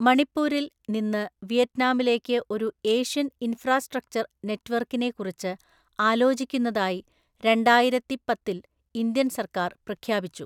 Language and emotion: Malayalam, neutral